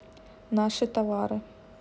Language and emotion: Russian, neutral